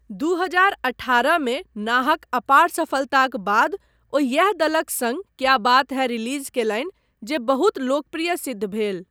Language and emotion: Maithili, neutral